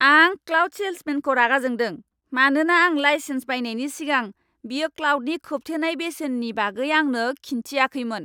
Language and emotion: Bodo, angry